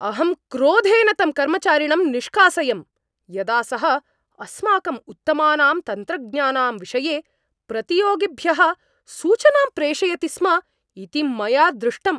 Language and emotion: Sanskrit, angry